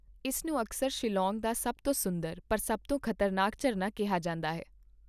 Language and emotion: Punjabi, neutral